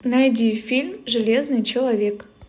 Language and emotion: Russian, positive